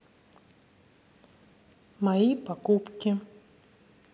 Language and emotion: Russian, neutral